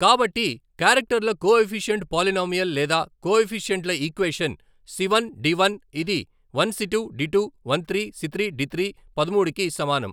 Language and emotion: Telugu, neutral